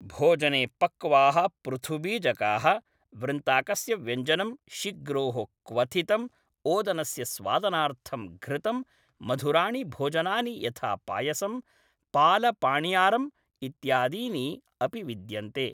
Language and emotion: Sanskrit, neutral